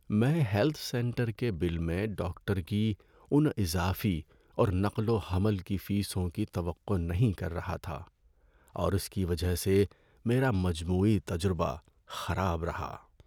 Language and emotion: Urdu, sad